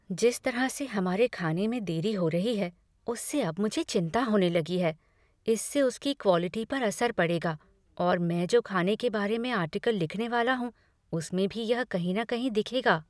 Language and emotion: Hindi, fearful